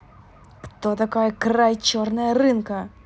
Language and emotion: Russian, angry